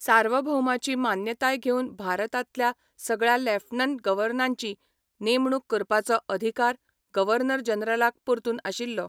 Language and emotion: Goan Konkani, neutral